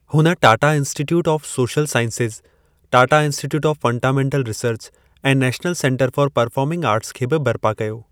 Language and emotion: Sindhi, neutral